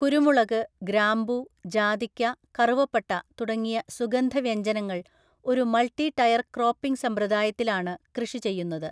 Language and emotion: Malayalam, neutral